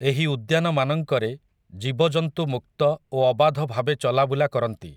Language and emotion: Odia, neutral